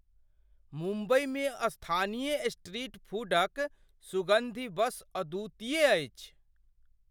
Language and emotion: Maithili, surprised